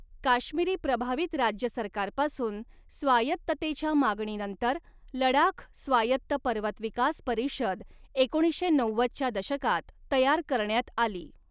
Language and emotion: Marathi, neutral